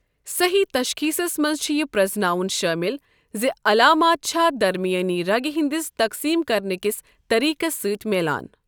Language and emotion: Kashmiri, neutral